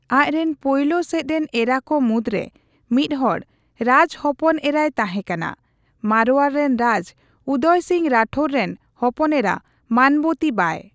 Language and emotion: Santali, neutral